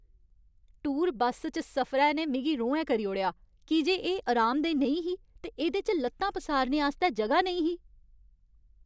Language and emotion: Dogri, angry